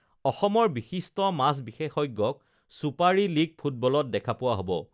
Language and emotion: Assamese, neutral